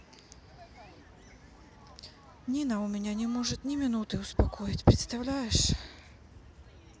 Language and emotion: Russian, sad